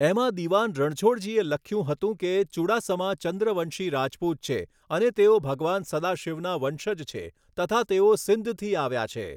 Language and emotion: Gujarati, neutral